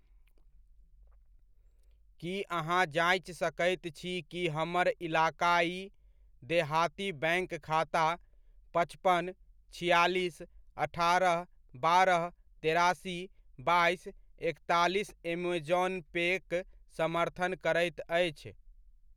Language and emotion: Maithili, neutral